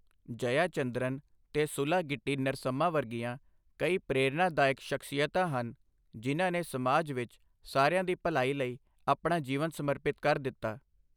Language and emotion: Punjabi, neutral